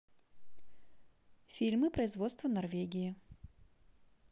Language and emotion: Russian, neutral